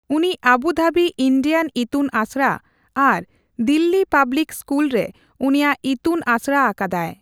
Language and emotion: Santali, neutral